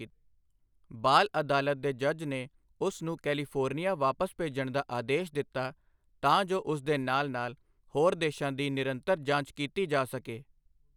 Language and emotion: Punjabi, neutral